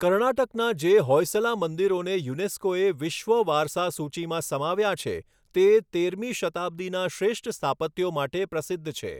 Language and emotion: Gujarati, neutral